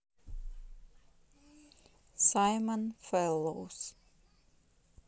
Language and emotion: Russian, neutral